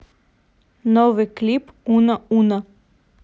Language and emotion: Russian, neutral